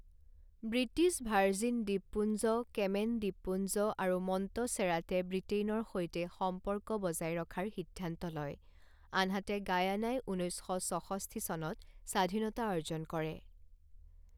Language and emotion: Assamese, neutral